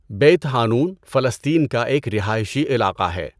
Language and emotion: Urdu, neutral